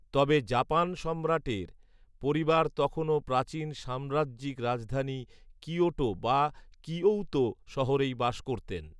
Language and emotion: Bengali, neutral